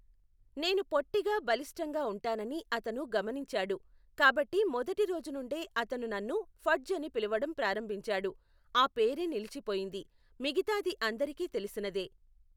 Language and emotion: Telugu, neutral